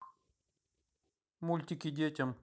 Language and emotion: Russian, neutral